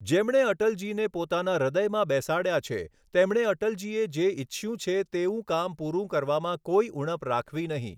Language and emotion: Gujarati, neutral